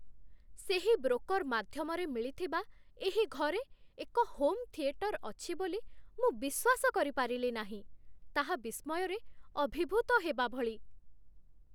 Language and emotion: Odia, surprised